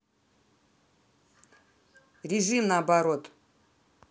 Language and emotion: Russian, angry